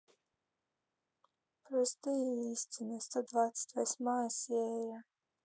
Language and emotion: Russian, sad